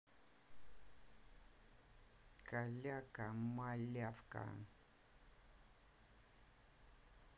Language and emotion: Russian, positive